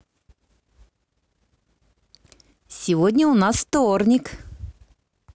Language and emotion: Russian, positive